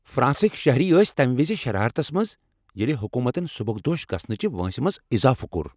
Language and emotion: Kashmiri, angry